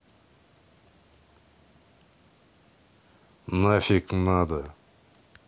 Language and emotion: Russian, neutral